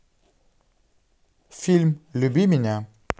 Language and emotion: Russian, neutral